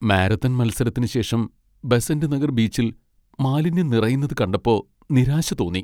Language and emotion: Malayalam, sad